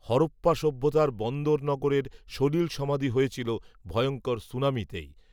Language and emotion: Bengali, neutral